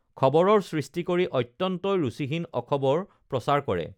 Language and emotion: Assamese, neutral